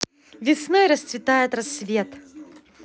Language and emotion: Russian, positive